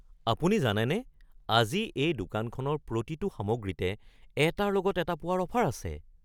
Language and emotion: Assamese, surprised